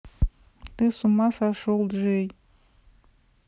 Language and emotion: Russian, neutral